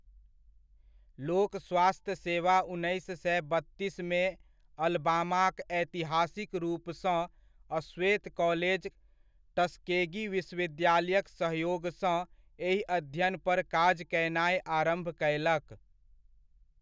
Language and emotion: Maithili, neutral